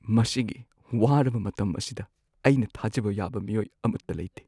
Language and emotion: Manipuri, sad